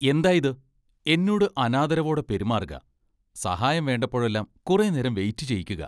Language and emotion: Malayalam, disgusted